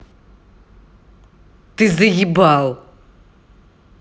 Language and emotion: Russian, angry